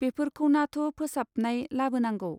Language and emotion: Bodo, neutral